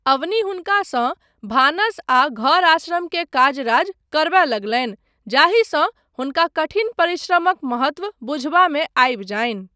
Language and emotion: Maithili, neutral